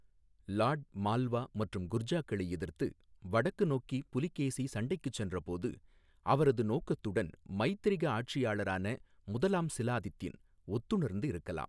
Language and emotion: Tamil, neutral